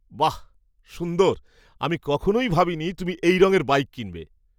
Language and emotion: Bengali, surprised